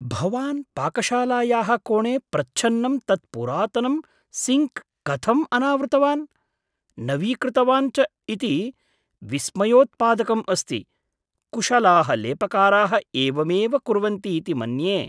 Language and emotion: Sanskrit, surprised